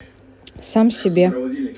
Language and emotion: Russian, neutral